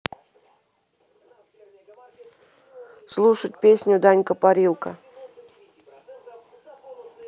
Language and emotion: Russian, neutral